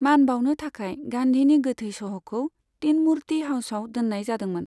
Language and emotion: Bodo, neutral